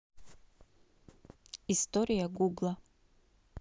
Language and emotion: Russian, neutral